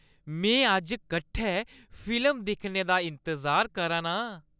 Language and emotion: Dogri, happy